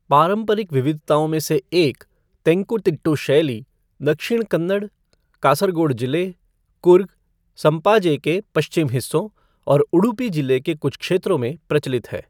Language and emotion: Hindi, neutral